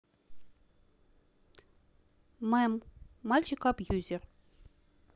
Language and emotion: Russian, neutral